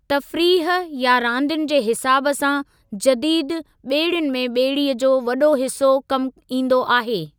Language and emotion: Sindhi, neutral